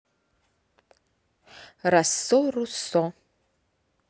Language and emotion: Russian, neutral